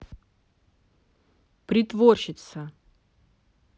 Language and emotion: Russian, angry